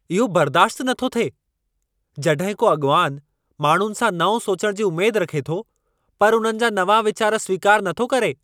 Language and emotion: Sindhi, angry